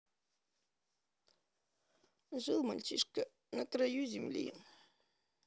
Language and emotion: Russian, sad